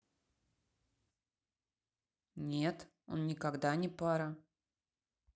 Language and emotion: Russian, neutral